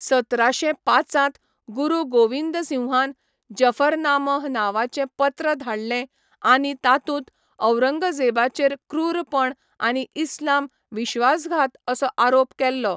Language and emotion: Goan Konkani, neutral